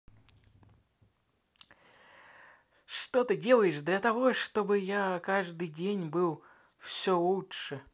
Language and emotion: Russian, positive